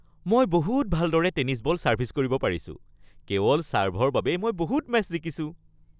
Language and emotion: Assamese, happy